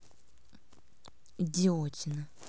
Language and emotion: Russian, angry